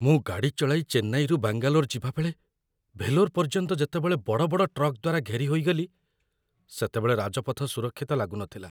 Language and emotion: Odia, fearful